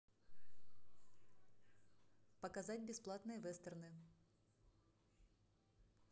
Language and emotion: Russian, neutral